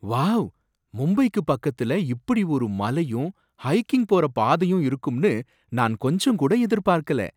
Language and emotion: Tamil, surprised